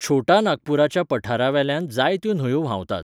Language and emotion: Goan Konkani, neutral